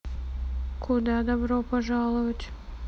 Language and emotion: Russian, neutral